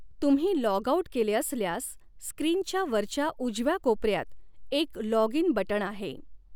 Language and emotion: Marathi, neutral